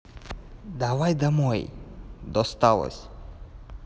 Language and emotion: Russian, neutral